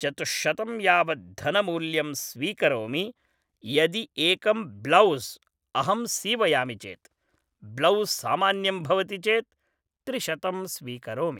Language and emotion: Sanskrit, neutral